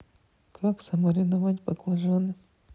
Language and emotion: Russian, neutral